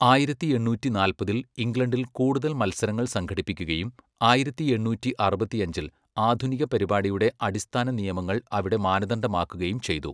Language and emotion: Malayalam, neutral